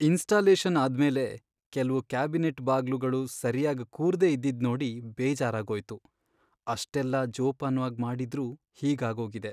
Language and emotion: Kannada, sad